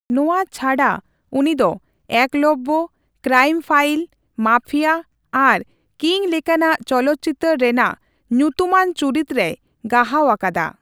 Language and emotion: Santali, neutral